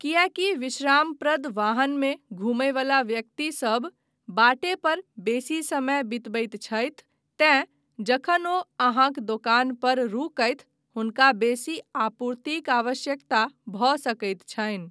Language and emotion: Maithili, neutral